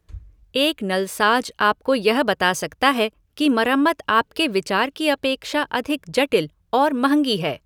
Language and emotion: Hindi, neutral